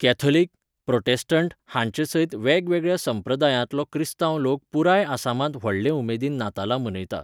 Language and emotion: Goan Konkani, neutral